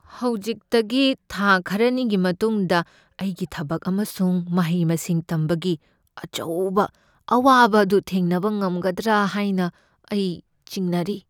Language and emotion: Manipuri, fearful